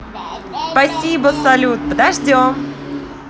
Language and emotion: Russian, positive